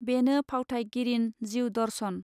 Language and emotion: Bodo, neutral